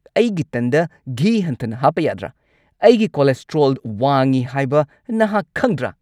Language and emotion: Manipuri, angry